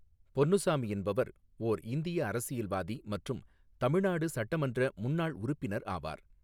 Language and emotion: Tamil, neutral